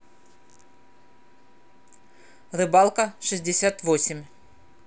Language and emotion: Russian, neutral